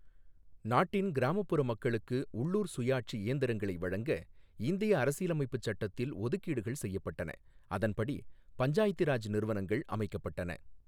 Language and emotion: Tamil, neutral